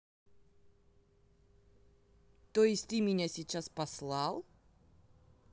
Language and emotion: Russian, neutral